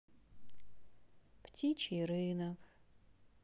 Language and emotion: Russian, sad